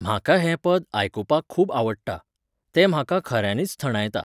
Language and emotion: Goan Konkani, neutral